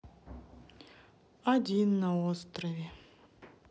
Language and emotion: Russian, sad